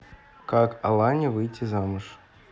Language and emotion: Russian, neutral